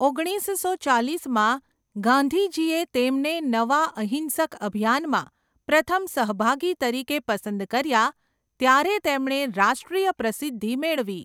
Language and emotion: Gujarati, neutral